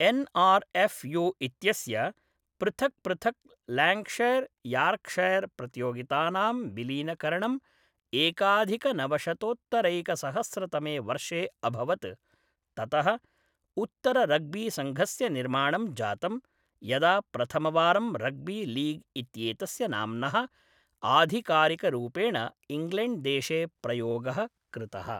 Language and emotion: Sanskrit, neutral